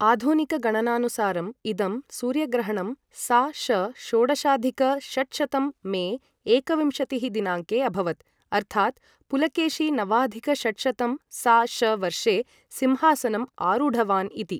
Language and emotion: Sanskrit, neutral